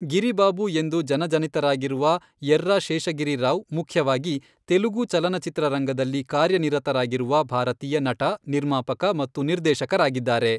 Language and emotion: Kannada, neutral